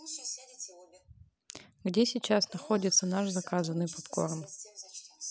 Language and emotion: Russian, neutral